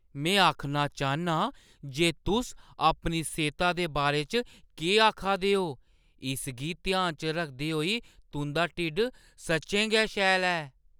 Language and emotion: Dogri, surprised